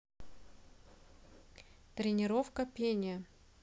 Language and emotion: Russian, neutral